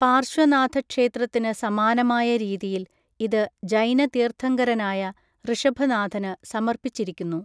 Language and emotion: Malayalam, neutral